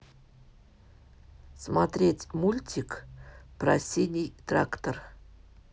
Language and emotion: Russian, neutral